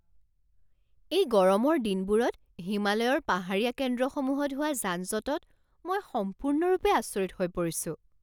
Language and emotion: Assamese, surprised